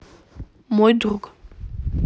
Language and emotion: Russian, neutral